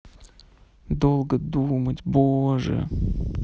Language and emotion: Russian, sad